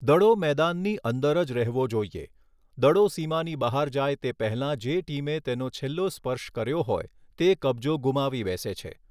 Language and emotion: Gujarati, neutral